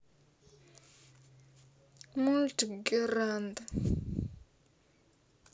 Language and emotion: Russian, sad